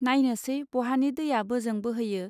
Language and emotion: Bodo, neutral